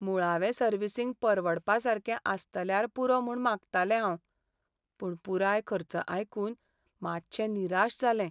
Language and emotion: Goan Konkani, sad